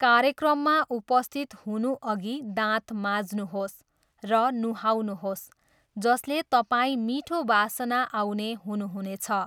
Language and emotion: Nepali, neutral